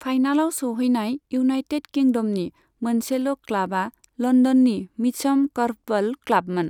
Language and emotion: Bodo, neutral